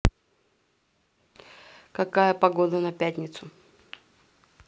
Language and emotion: Russian, neutral